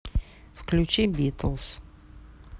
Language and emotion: Russian, neutral